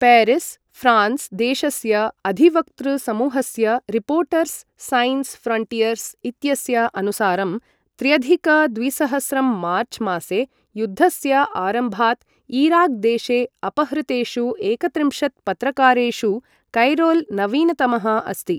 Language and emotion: Sanskrit, neutral